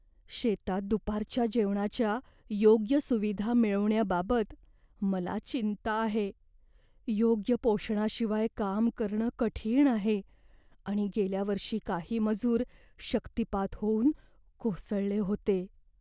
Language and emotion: Marathi, fearful